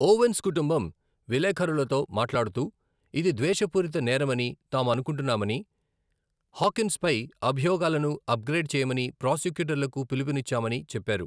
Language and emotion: Telugu, neutral